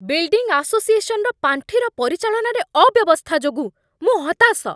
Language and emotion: Odia, angry